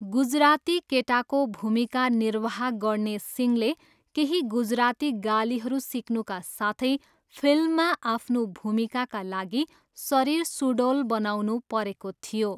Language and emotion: Nepali, neutral